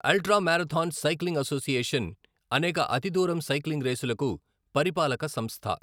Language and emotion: Telugu, neutral